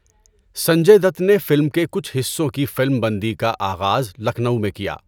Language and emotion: Urdu, neutral